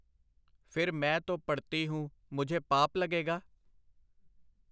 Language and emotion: Punjabi, neutral